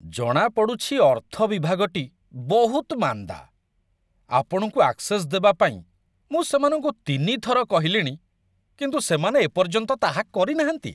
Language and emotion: Odia, disgusted